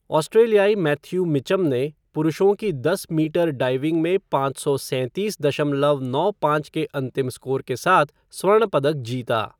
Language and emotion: Hindi, neutral